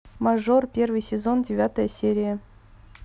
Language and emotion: Russian, neutral